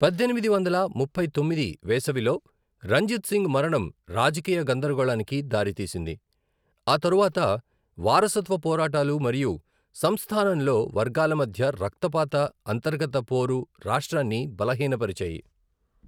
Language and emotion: Telugu, neutral